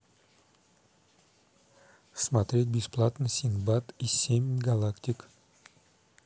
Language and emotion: Russian, neutral